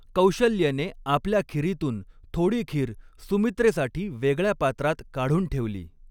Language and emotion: Marathi, neutral